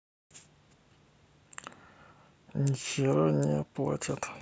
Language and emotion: Russian, sad